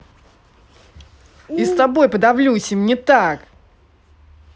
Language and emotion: Russian, angry